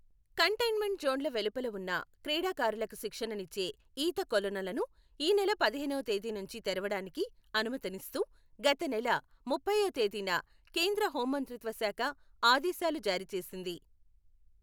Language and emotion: Telugu, neutral